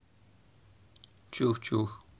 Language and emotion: Russian, neutral